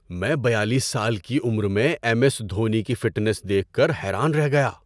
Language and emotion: Urdu, surprised